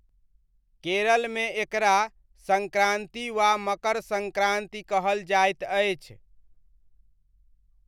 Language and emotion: Maithili, neutral